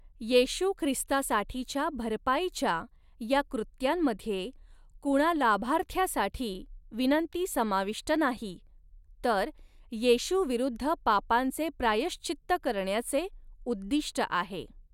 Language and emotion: Marathi, neutral